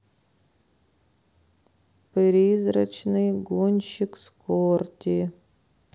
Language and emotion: Russian, sad